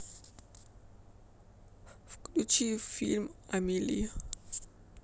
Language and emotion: Russian, sad